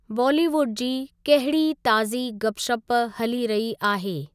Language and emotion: Sindhi, neutral